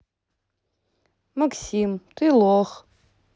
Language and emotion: Russian, neutral